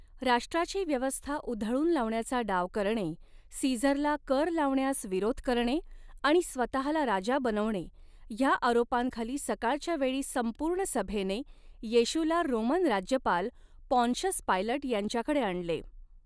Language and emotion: Marathi, neutral